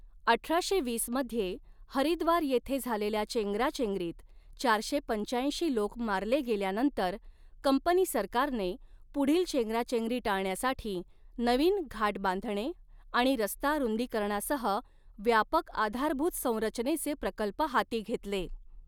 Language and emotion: Marathi, neutral